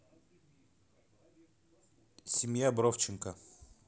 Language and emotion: Russian, neutral